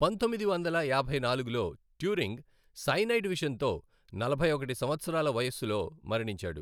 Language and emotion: Telugu, neutral